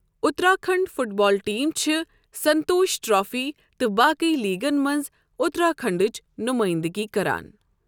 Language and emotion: Kashmiri, neutral